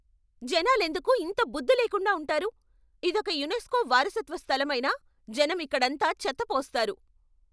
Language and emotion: Telugu, angry